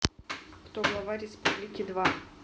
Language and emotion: Russian, neutral